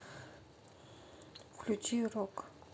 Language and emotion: Russian, neutral